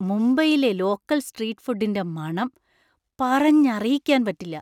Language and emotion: Malayalam, surprised